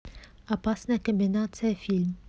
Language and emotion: Russian, neutral